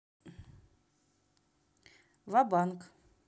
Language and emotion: Russian, neutral